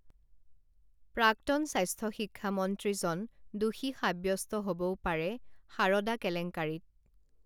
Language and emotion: Assamese, neutral